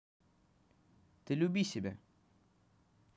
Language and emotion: Russian, neutral